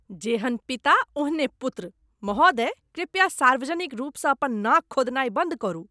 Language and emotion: Maithili, disgusted